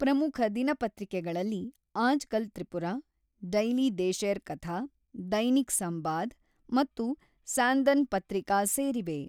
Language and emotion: Kannada, neutral